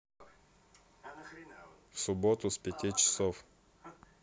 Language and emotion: Russian, neutral